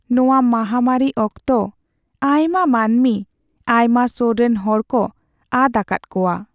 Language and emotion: Santali, sad